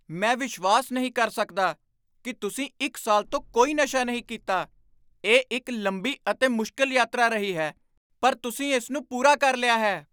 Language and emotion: Punjabi, surprised